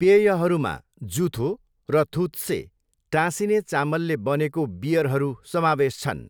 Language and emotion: Nepali, neutral